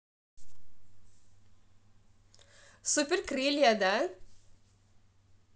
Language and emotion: Russian, positive